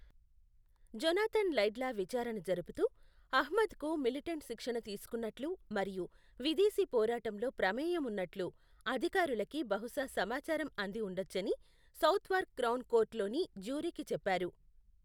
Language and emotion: Telugu, neutral